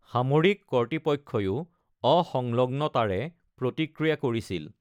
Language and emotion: Assamese, neutral